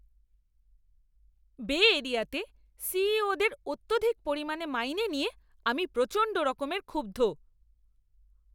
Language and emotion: Bengali, angry